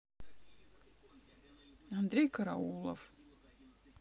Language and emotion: Russian, neutral